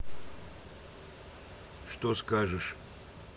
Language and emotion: Russian, neutral